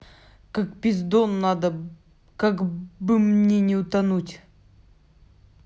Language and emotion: Russian, angry